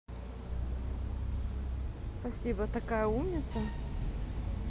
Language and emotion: Russian, positive